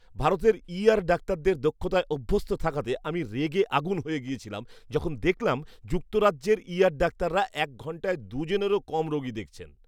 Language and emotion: Bengali, disgusted